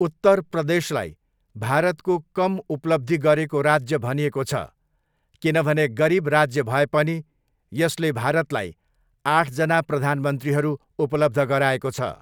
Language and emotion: Nepali, neutral